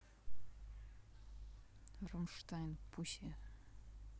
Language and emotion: Russian, angry